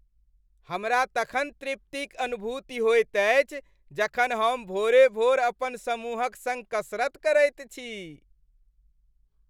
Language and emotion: Maithili, happy